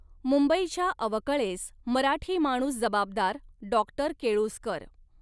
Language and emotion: Marathi, neutral